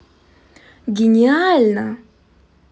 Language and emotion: Russian, positive